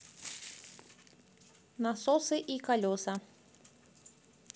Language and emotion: Russian, positive